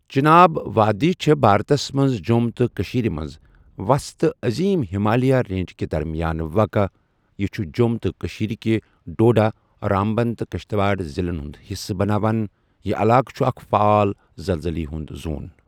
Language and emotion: Kashmiri, neutral